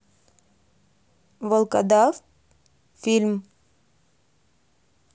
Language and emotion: Russian, neutral